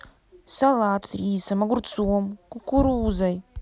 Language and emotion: Russian, neutral